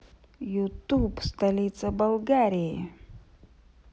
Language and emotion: Russian, positive